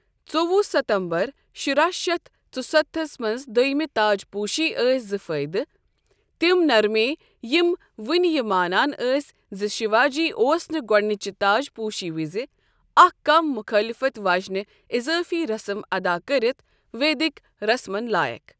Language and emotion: Kashmiri, neutral